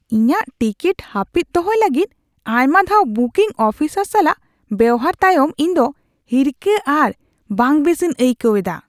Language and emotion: Santali, disgusted